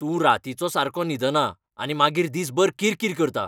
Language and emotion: Goan Konkani, angry